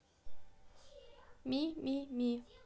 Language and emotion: Russian, neutral